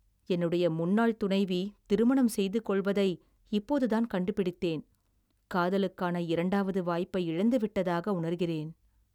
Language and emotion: Tamil, sad